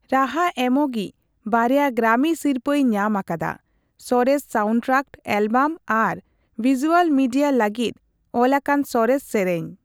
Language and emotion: Santali, neutral